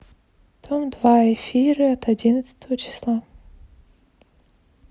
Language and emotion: Russian, neutral